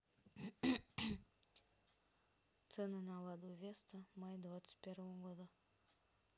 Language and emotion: Russian, neutral